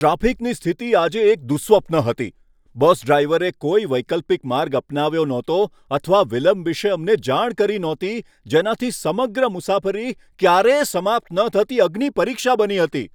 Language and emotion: Gujarati, angry